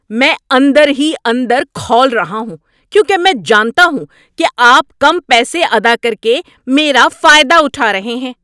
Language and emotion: Urdu, angry